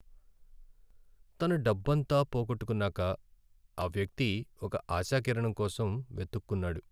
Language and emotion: Telugu, sad